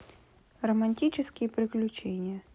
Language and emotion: Russian, neutral